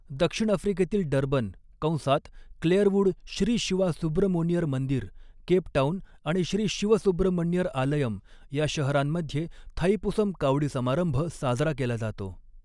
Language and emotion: Marathi, neutral